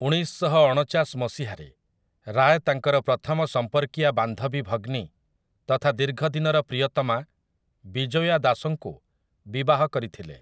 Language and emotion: Odia, neutral